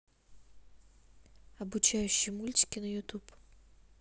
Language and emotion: Russian, neutral